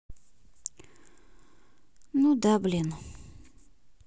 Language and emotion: Russian, sad